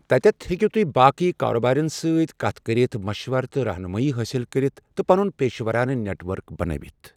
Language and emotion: Kashmiri, neutral